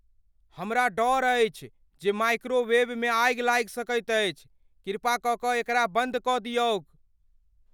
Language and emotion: Maithili, fearful